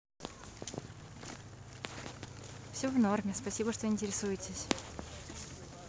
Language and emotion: Russian, neutral